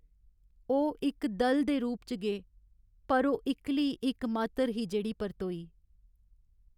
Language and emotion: Dogri, sad